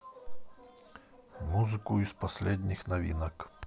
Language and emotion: Russian, neutral